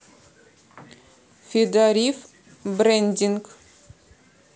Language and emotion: Russian, neutral